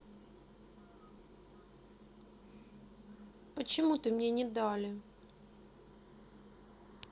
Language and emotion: Russian, sad